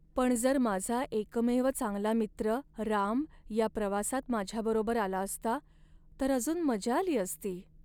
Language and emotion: Marathi, sad